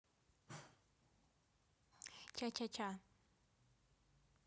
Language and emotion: Russian, neutral